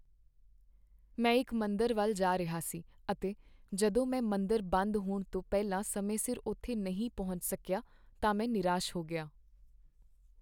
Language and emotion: Punjabi, sad